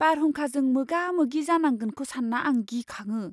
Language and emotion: Bodo, fearful